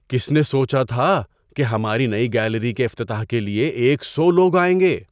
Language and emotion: Urdu, surprised